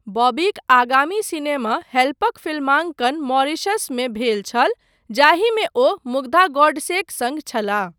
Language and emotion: Maithili, neutral